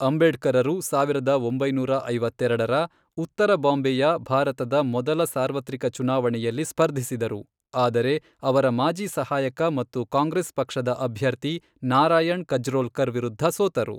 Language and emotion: Kannada, neutral